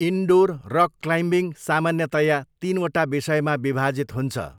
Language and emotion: Nepali, neutral